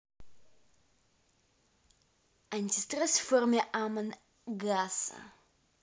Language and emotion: Russian, neutral